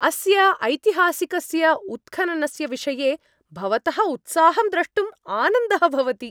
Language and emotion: Sanskrit, happy